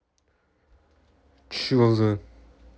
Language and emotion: Russian, angry